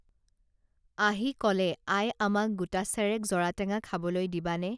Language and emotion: Assamese, neutral